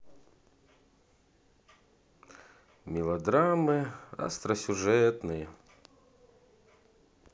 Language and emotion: Russian, sad